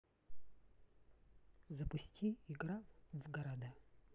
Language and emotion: Russian, neutral